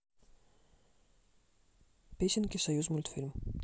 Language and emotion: Russian, neutral